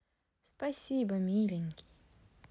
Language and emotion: Russian, positive